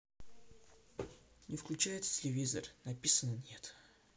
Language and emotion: Russian, sad